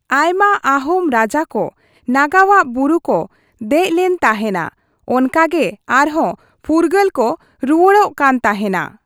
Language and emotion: Santali, neutral